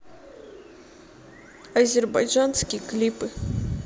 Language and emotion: Russian, sad